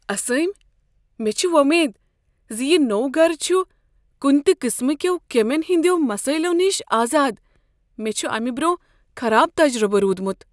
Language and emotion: Kashmiri, fearful